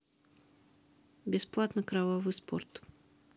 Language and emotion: Russian, neutral